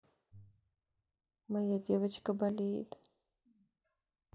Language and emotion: Russian, sad